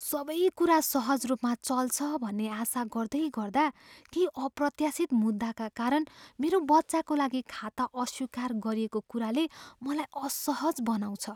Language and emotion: Nepali, fearful